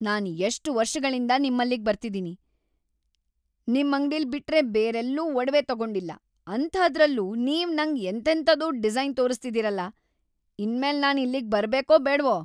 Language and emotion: Kannada, angry